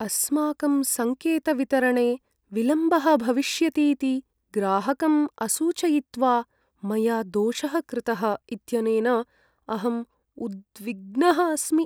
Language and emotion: Sanskrit, sad